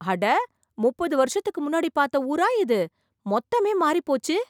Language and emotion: Tamil, surprised